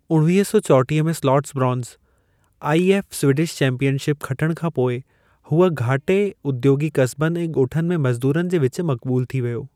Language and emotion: Sindhi, neutral